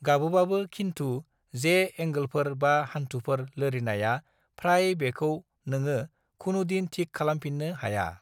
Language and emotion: Bodo, neutral